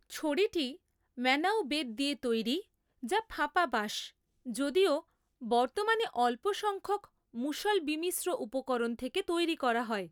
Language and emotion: Bengali, neutral